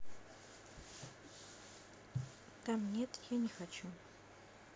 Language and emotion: Russian, neutral